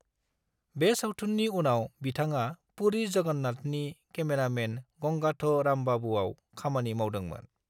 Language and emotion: Bodo, neutral